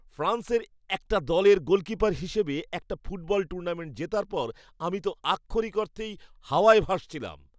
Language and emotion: Bengali, happy